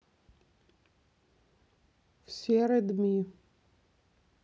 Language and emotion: Russian, neutral